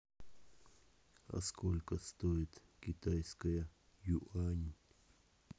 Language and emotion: Russian, neutral